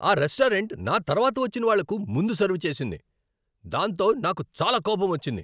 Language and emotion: Telugu, angry